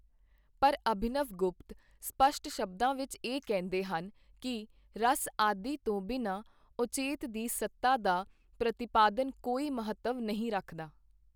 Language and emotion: Punjabi, neutral